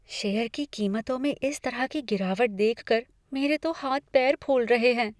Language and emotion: Hindi, fearful